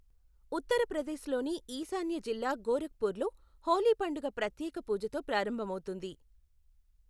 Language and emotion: Telugu, neutral